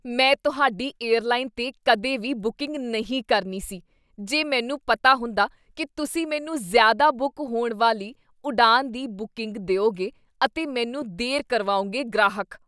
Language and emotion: Punjabi, disgusted